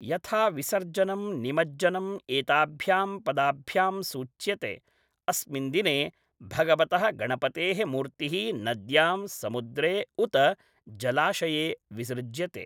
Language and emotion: Sanskrit, neutral